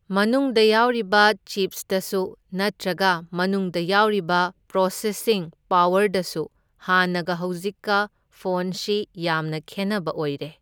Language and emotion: Manipuri, neutral